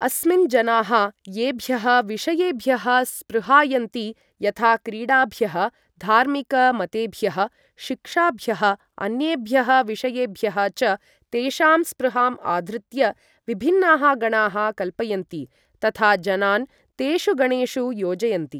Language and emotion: Sanskrit, neutral